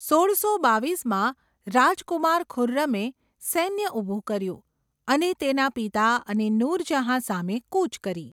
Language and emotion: Gujarati, neutral